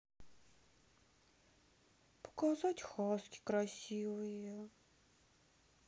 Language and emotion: Russian, sad